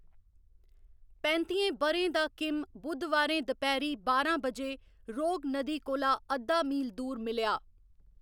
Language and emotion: Dogri, neutral